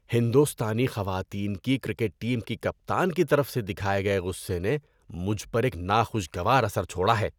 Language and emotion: Urdu, disgusted